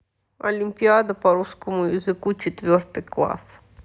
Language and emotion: Russian, neutral